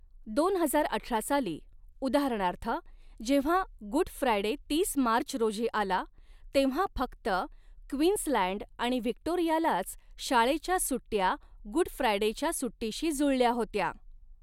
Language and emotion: Marathi, neutral